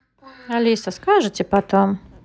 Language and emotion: Russian, neutral